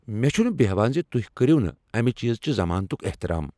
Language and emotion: Kashmiri, angry